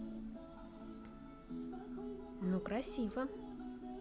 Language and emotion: Russian, positive